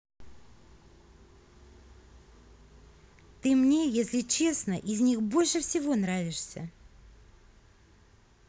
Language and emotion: Russian, positive